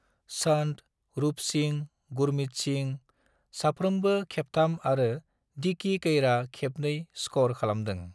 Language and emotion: Bodo, neutral